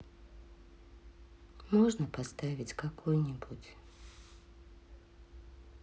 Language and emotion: Russian, sad